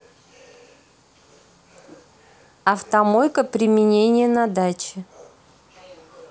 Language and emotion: Russian, neutral